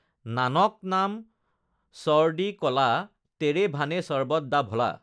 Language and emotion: Assamese, neutral